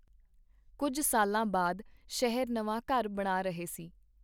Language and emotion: Punjabi, neutral